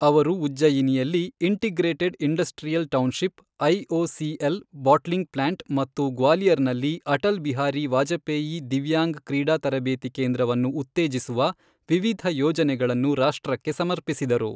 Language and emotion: Kannada, neutral